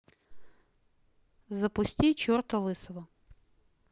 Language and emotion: Russian, neutral